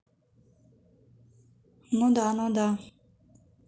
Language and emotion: Russian, neutral